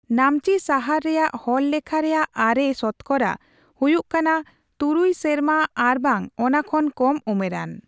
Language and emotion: Santali, neutral